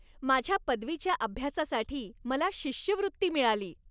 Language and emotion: Marathi, happy